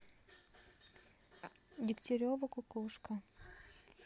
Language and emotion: Russian, neutral